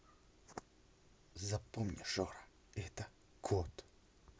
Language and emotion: Russian, angry